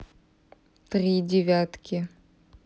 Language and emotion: Russian, neutral